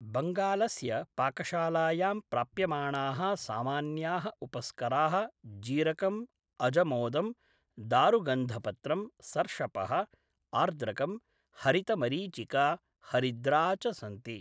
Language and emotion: Sanskrit, neutral